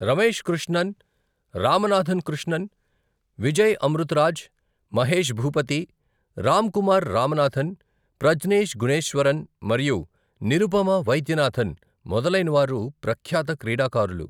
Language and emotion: Telugu, neutral